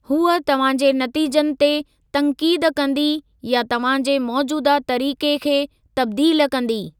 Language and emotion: Sindhi, neutral